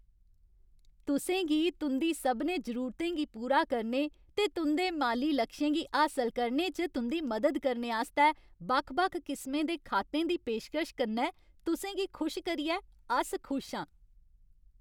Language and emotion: Dogri, happy